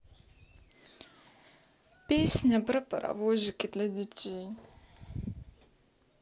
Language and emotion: Russian, sad